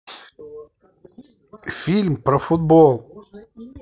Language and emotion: Russian, neutral